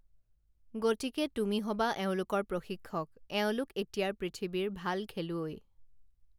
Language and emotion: Assamese, neutral